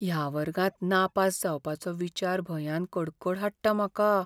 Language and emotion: Goan Konkani, fearful